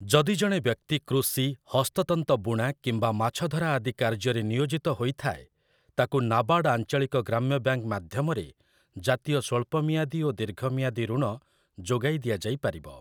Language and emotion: Odia, neutral